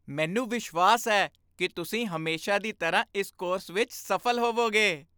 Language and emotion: Punjabi, happy